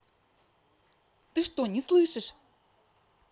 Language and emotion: Russian, angry